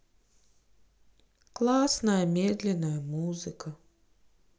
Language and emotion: Russian, sad